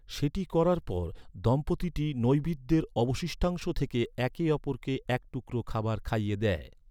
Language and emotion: Bengali, neutral